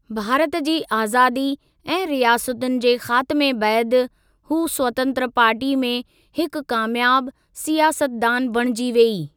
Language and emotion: Sindhi, neutral